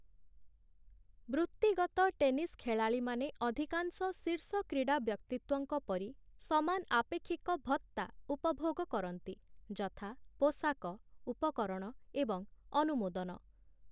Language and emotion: Odia, neutral